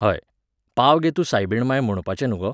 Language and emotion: Goan Konkani, neutral